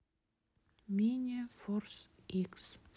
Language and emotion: Russian, neutral